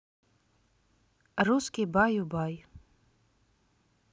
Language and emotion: Russian, neutral